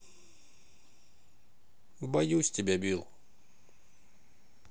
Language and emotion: Russian, sad